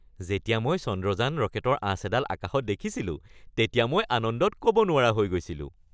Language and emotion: Assamese, happy